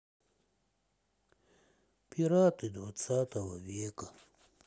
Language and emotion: Russian, sad